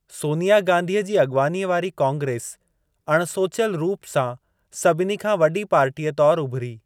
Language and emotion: Sindhi, neutral